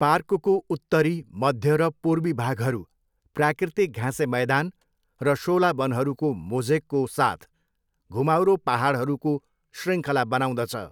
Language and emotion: Nepali, neutral